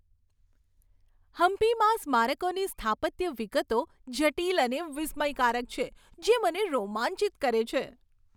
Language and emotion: Gujarati, happy